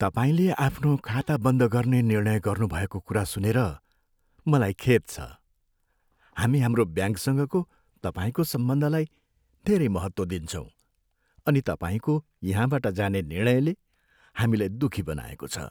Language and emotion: Nepali, sad